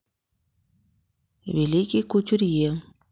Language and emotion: Russian, neutral